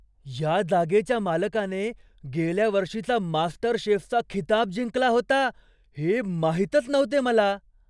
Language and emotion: Marathi, surprised